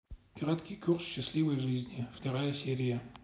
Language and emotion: Russian, neutral